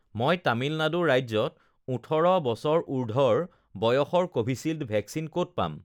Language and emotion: Assamese, neutral